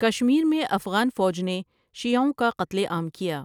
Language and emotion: Urdu, neutral